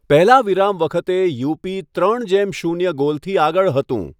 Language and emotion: Gujarati, neutral